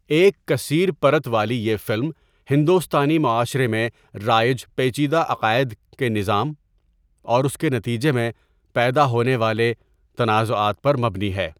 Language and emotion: Urdu, neutral